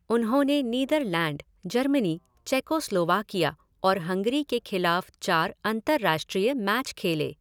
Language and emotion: Hindi, neutral